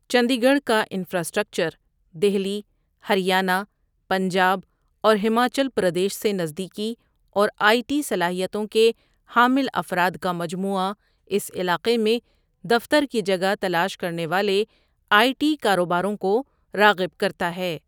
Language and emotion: Urdu, neutral